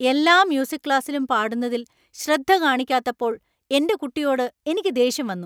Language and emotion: Malayalam, angry